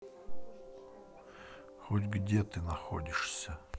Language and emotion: Russian, sad